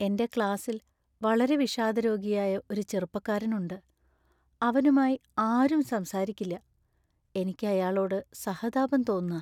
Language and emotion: Malayalam, sad